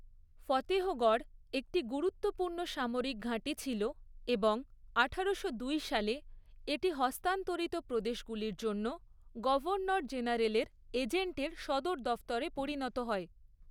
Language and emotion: Bengali, neutral